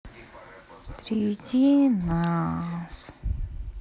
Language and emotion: Russian, sad